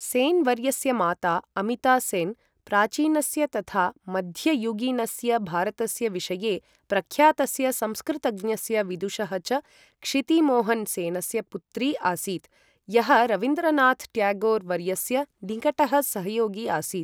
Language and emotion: Sanskrit, neutral